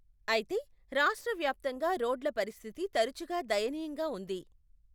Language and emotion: Telugu, neutral